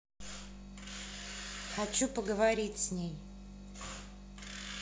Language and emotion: Russian, angry